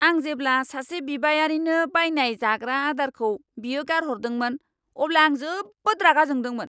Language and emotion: Bodo, angry